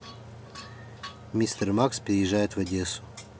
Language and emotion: Russian, neutral